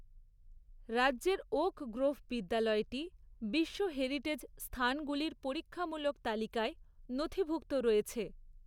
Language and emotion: Bengali, neutral